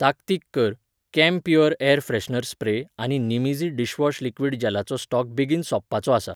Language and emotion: Goan Konkani, neutral